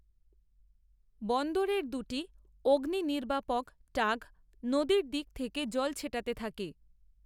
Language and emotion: Bengali, neutral